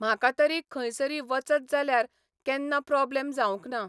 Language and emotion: Goan Konkani, neutral